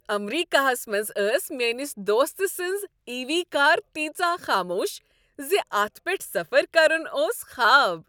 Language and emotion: Kashmiri, happy